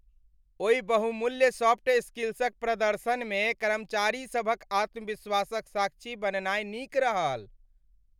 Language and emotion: Maithili, happy